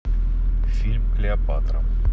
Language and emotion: Russian, neutral